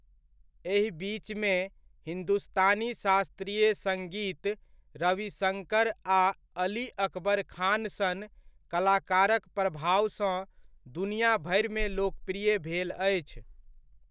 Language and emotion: Maithili, neutral